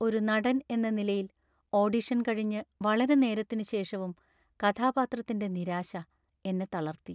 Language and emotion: Malayalam, sad